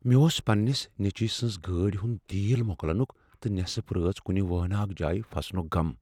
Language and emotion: Kashmiri, fearful